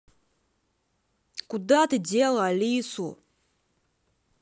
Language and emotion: Russian, angry